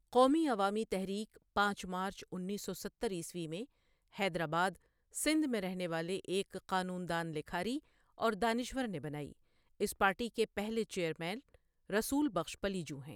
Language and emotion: Urdu, neutral